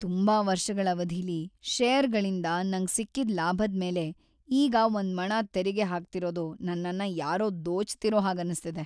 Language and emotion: Kannada, sad